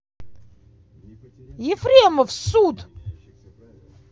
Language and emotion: Russian, angry